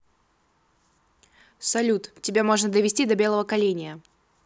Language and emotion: Russian, angry